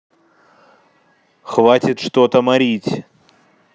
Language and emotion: Russian, angry